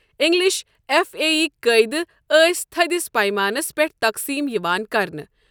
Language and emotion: Kashmiri, neutral